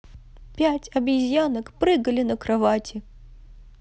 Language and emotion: Russian, sad